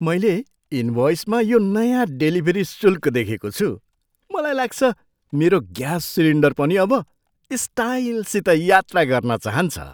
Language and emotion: Nepali, surprised